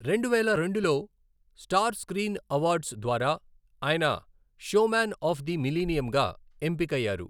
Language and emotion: Telugu, neutral